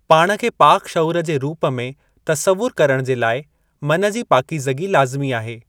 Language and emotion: Sindhi, neutral